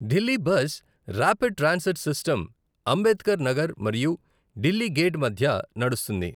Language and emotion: Telugu, neutral